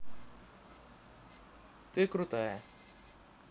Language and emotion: Russian, neutral